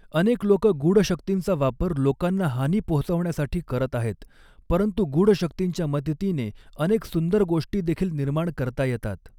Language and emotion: Marathi, neutral